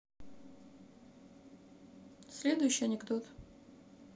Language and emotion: Russian, neutral